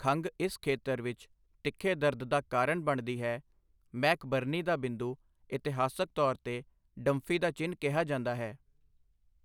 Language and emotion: Punjabi, neutral